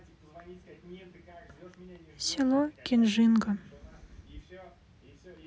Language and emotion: Russian, sad